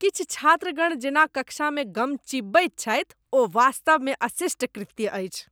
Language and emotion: Maithili, disgusted